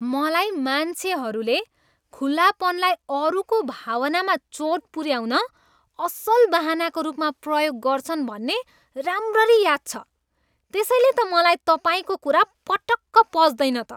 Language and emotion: Nepali, disgusted